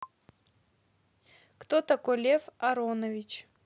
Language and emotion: Russian, neutral